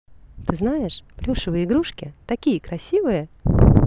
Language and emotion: Russian, positive